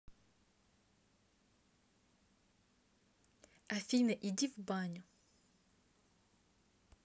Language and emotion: Russian, neutral